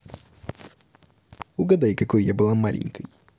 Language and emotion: Russian, positive